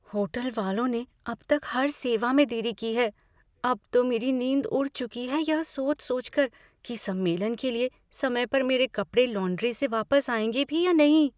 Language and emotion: Hindi, fearful